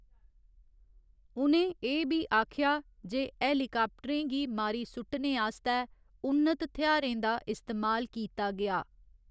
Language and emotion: Dogri, neutral